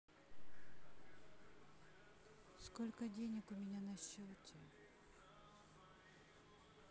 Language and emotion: Russian, neutral